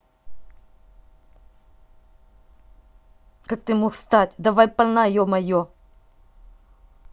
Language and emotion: Russian, angry